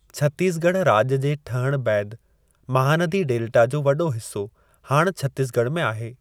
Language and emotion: Sindhi, neutral